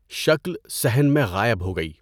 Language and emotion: Urdu, neutral